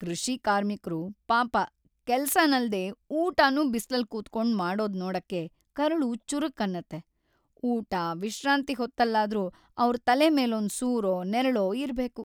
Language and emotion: Kannada, sad